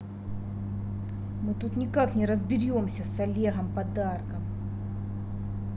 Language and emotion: Russian, angry